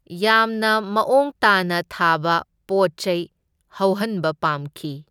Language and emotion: Manipuri, neutral